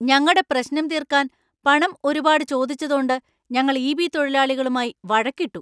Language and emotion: Malayalam, angry